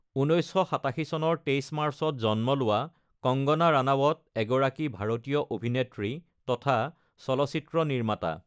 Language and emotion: Assamese, neutral